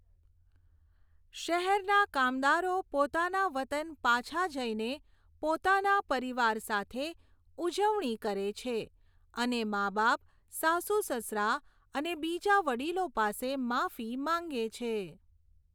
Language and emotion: Gujarati, neutral